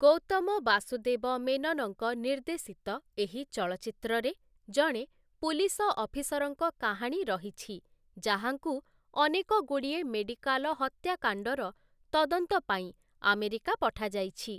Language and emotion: Odia, neutral